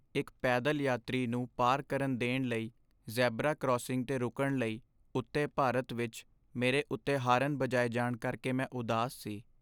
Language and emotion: Punjabi, sad